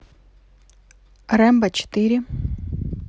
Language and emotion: Russian, neutral